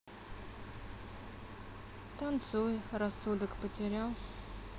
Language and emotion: Russian, sad